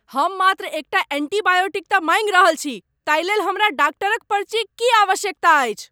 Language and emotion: Maithili, angry